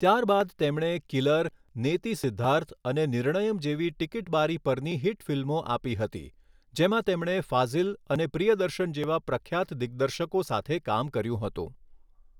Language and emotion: Gujarati, neutral